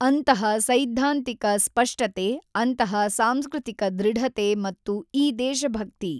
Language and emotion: Kannada, neutral